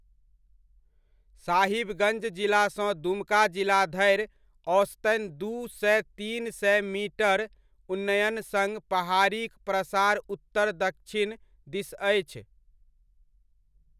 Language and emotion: Maithili, neutral